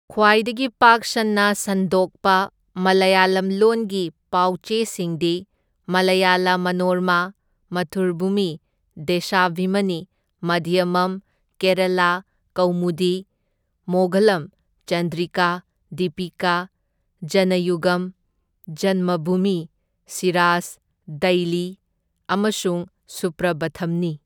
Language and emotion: Manipuri, neutral